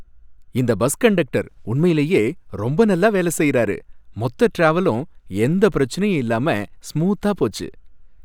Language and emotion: Tamil, happy